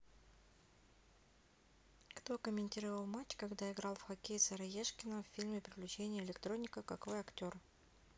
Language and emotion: Russian, neutral